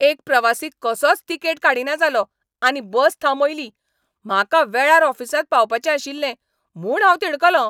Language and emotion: Goan Konkani, angry